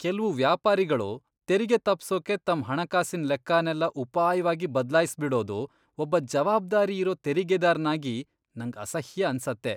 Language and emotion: Kannada, disgusted